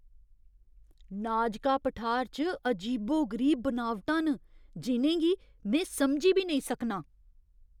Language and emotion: Dogri, surprised